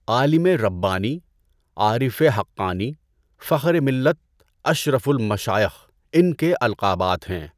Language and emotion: Urdu, neutral